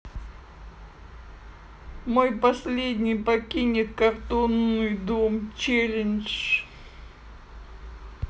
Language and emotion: Russian, sad